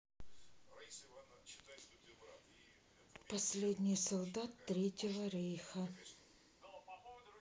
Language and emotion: Russian, neutral